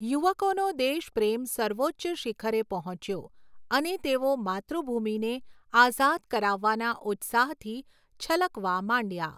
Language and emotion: Gujarati, neutral